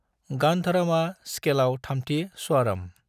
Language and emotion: Bodo, neutral